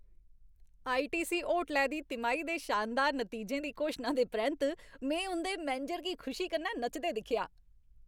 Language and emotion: Dogri, happy